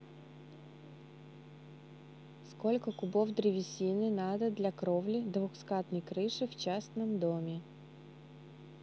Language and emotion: Russian, neutral